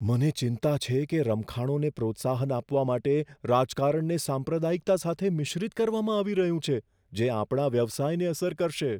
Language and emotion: Gujarati, fearful